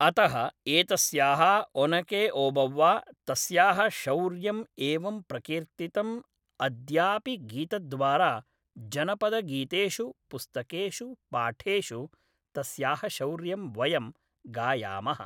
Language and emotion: Sanskrit, neutral